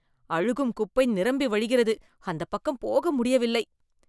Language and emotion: Tamil, disgusted